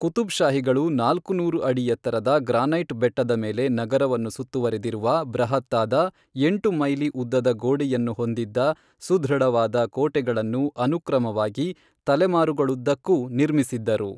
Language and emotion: Kannada, neutral